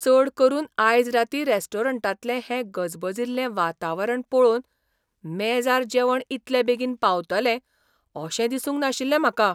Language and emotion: Goan Konkani, surprised